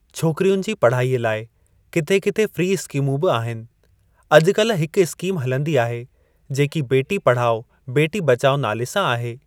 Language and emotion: Sindhi, neutral